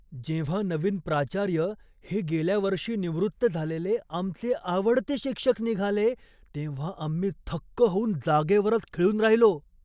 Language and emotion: Marathi, surprised